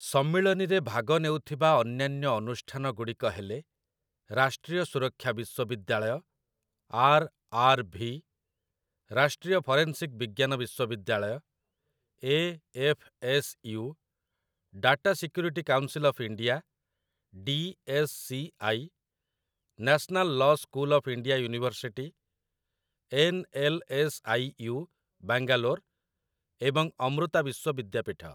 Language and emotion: Odia, neutral